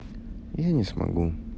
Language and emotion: Russian, sad